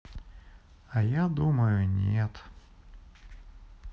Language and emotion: Russian, sad